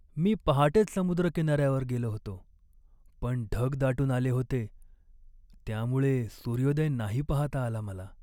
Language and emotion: Marathi, sad